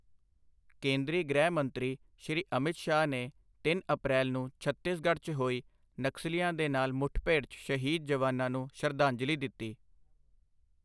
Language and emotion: Punjabi, neutral